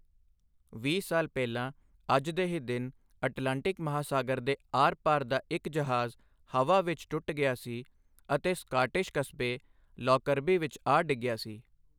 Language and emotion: Punjabi, neutral